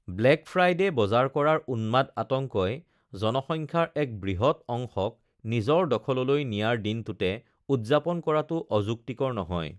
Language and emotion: Assamese, neutral